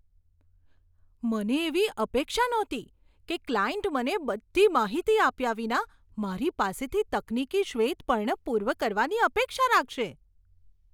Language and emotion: Gujarati, surprised